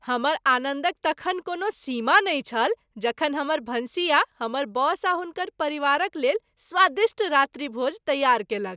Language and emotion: Maithili, happy